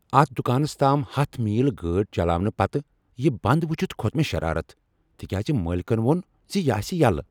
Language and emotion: Kashmiri, angry